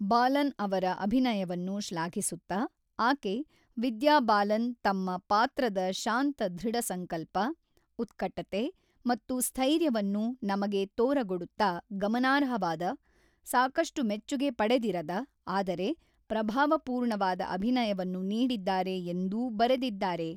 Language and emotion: Kannada, neutral